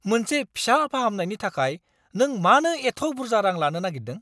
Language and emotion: Bodo, angry